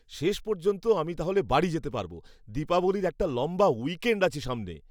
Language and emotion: Bengali, happy